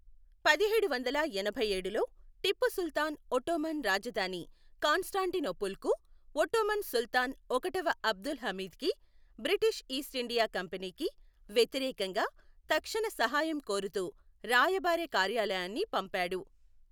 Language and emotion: Telugu, neutral